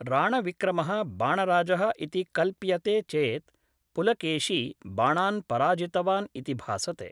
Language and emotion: Sanskrit, neutral